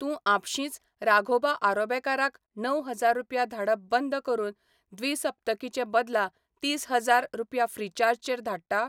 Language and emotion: Goan Konkani, neutral